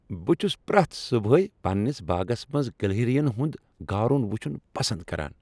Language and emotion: Kashmiri, happy